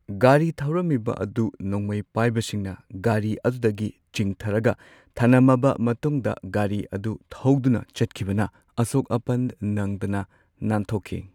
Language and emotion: Manipuri, neutral